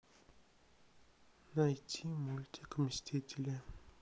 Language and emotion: Russian, neutral